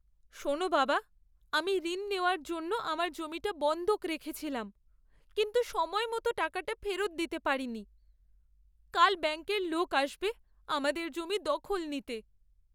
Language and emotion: Bengali, sad